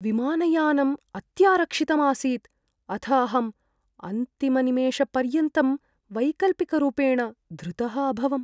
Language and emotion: Sanskrit, fearful